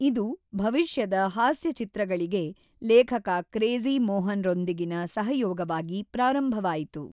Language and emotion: Kannada, neutral